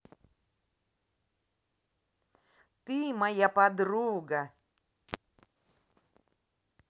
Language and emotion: Russian, positive